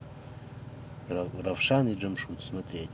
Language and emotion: Russian, neutral